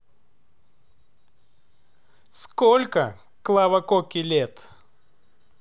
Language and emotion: Russian, neutral